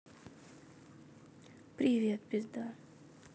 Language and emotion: Russian, sad